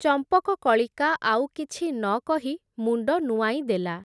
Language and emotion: Odia, neutral